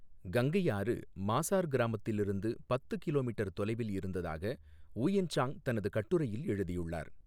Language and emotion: Tamil, neutral